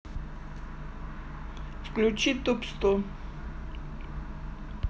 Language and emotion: Russian, neutral